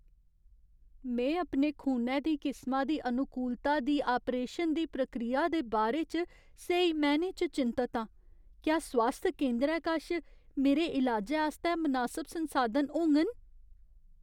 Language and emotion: Dogri, fearful